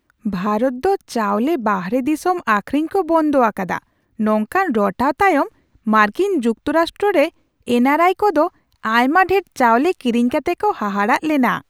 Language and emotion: Santali, surprised